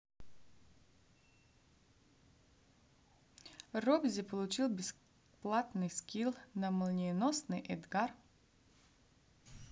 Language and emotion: Russian, neutral